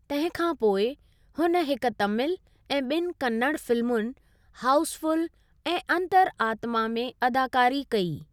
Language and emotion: Sindhi, neutral